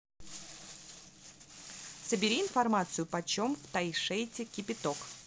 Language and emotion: Russian, neutral